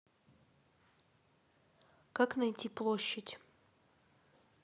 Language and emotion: Russian, neutral